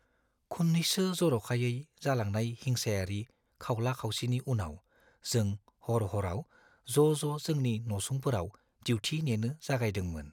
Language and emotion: Bodo, fearful